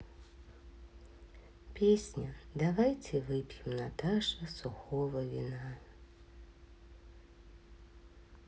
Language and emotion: Russian, sad